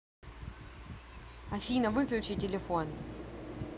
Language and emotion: Russian, angry